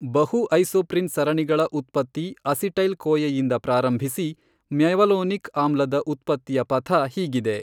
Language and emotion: Kannada, neutral